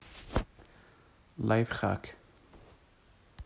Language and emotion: Russian, neutral